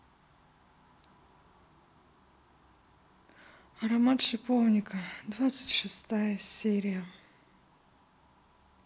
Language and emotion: Russian, sad